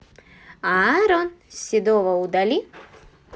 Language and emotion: Russian, positive